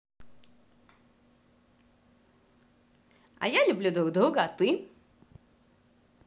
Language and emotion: Russian, positive